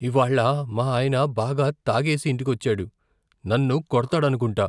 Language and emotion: Telugu, fearful